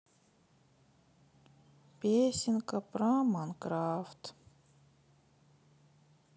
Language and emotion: Russian, sad